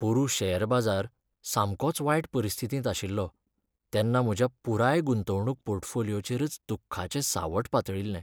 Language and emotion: Goan Konkani, sad